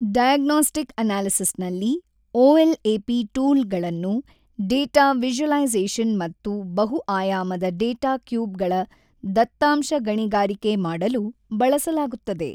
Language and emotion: Kannada, neutral